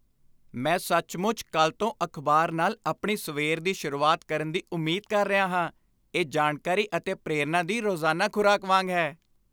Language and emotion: Punjabi, happy